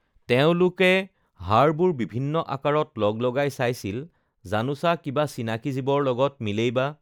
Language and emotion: Assamese, neutral